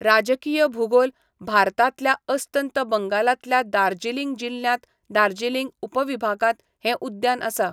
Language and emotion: Goan Konkani, neutral